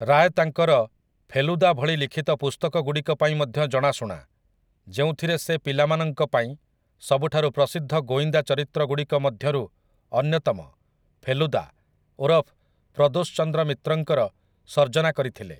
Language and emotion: Odia, neutral